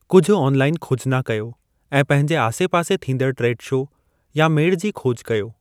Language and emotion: Sindhi, neutral